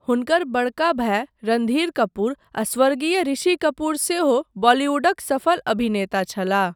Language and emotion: Maithili, neutral